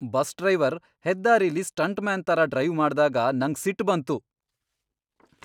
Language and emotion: Kannada, angry